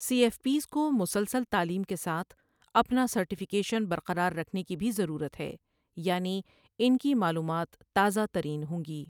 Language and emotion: Urdu, neutral